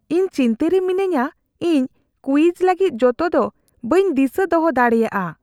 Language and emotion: Santali, fearful